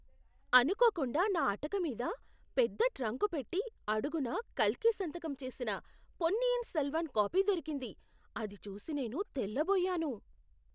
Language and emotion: Telugu, surprised